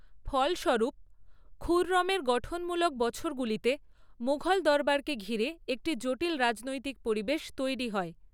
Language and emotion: Bengali, neutral